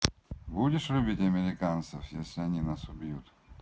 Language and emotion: Russian, neutral